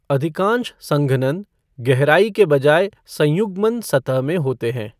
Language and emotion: Hindi, neutral